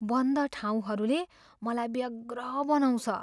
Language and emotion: Nepali, fearful